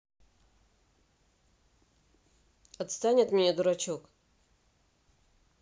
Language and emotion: Russian, angry